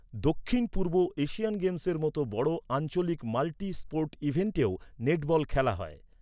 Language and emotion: Bengali, neutral